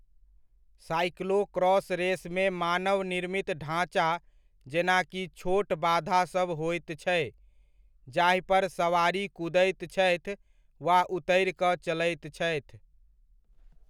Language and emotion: Maithili, neutral